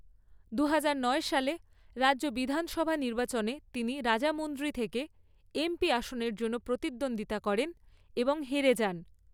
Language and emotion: Bengali, neutral